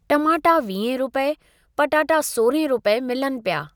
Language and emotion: Sindhi, neutral